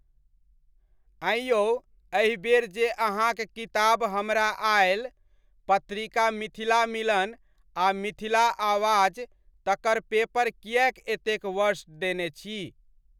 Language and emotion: Maithili, neutral